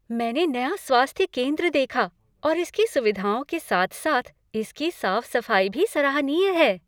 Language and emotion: Hindi, happy